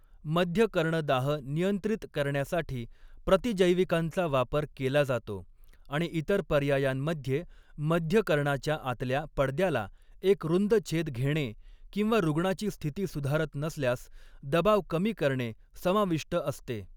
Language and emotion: Marathi, neutral